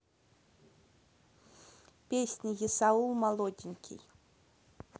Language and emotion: Russian, neutral